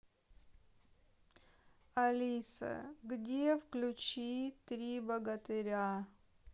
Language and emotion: Russian, sad